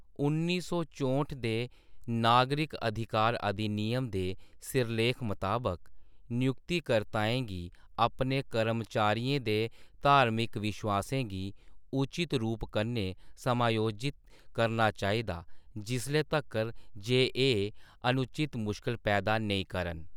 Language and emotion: Dogri, neutral